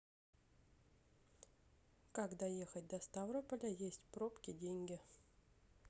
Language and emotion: Russian, neutral